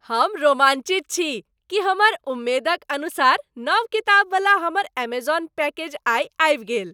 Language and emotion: Maithili, happy